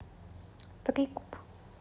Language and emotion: Russian, neutral